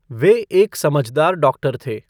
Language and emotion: Hindi, neutral